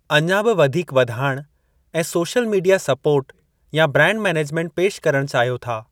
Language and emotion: Sindhi, neutral